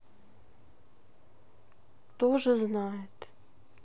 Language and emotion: Russian, sad